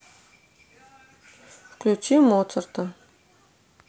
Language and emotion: Russian, neutral